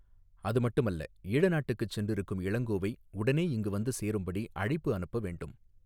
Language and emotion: Tamil, neutral